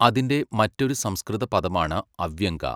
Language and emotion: Malayalam, neutral